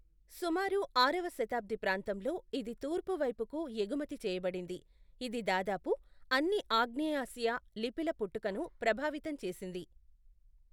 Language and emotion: Telugu, neutral